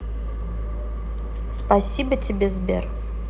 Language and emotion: Russian, neutral